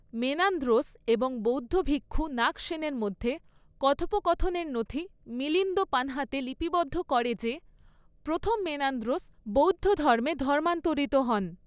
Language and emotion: Bengali, neutral